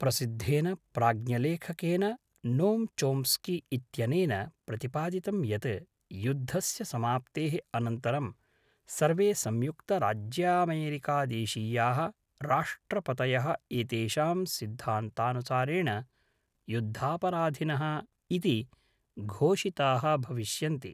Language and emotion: Sanskrit, neutral